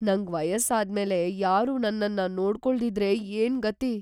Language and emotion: Kannada, fearful